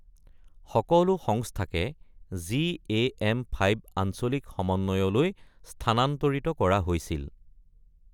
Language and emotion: Assamese, neutral